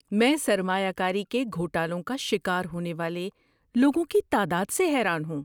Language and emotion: Urdu, surprised